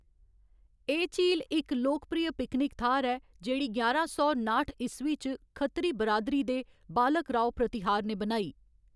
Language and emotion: Dogri, neutral